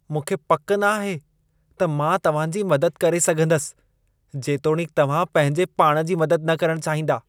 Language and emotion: Sindhi, disgusted